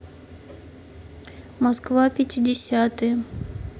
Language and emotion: Russian, neutral